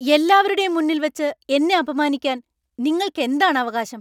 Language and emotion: Malayalam, angry